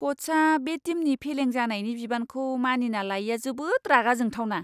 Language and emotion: Bodo, disgusted